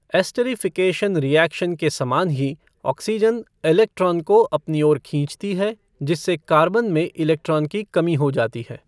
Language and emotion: Hindi, neutral